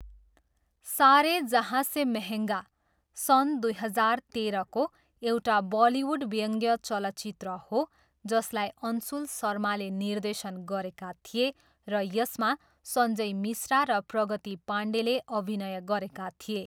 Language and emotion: Nepali, neutral